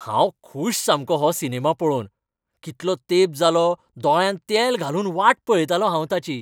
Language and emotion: Goan Konkani, happy